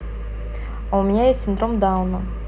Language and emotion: Russian, neutral